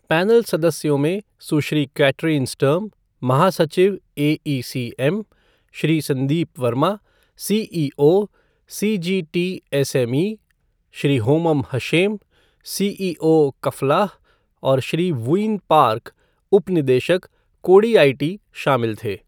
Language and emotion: Hindi, neutral